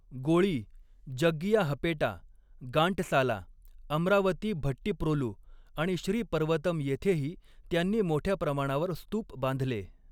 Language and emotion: Marathi, neutral